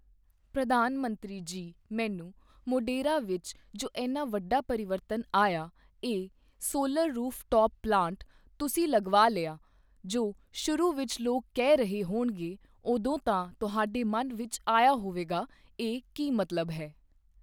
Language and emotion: Punjabi, neutral